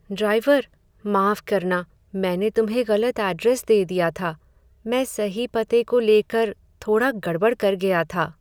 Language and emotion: Hindi, sad